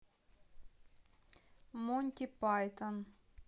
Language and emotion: Russian, neutral